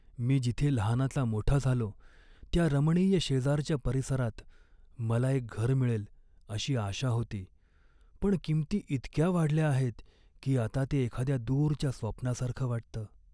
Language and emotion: Marathi, sad